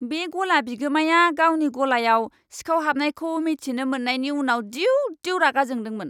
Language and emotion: Bodo, angry